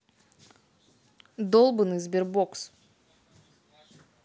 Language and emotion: Russian, angry